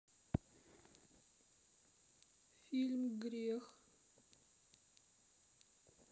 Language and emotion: Russian, sad